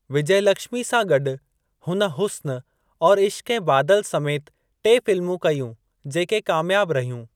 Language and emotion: Sindhi, neutral